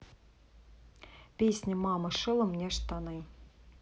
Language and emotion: Russian, neutral